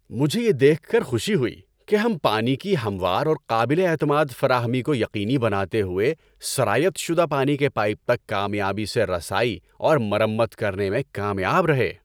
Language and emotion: Urdu, happy